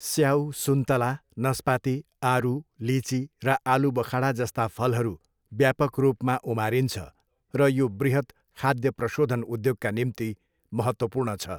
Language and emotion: Nepali, neutral